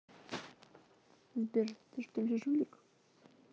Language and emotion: Russian, neutral